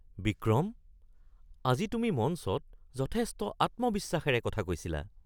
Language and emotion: Assamese, surprised